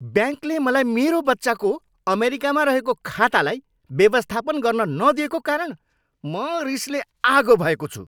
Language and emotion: Nepali, angry